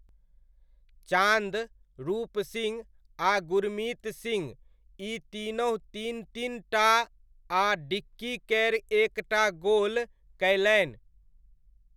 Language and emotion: Maithili, neutral